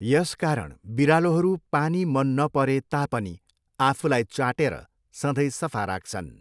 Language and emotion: Nepali, neutral